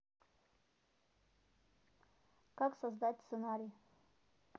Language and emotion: Russian, neutral